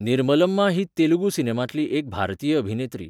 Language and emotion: Goan Konkani, neutral